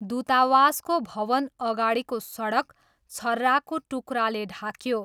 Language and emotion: Nepali, neutral